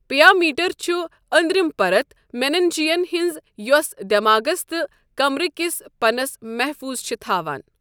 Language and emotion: Kashmiri, neutral